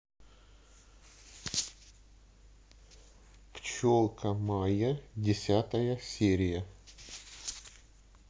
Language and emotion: Russian, neutral